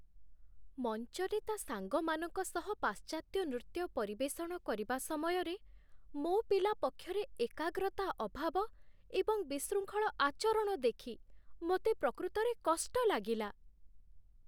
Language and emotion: Odia, sad